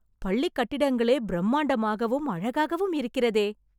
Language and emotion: Tamil, happy